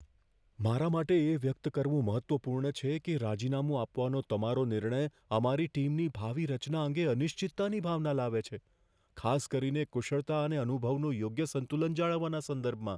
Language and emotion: Gujarati, fearful